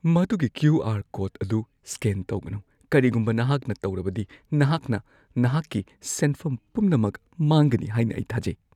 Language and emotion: Manipuri, fearful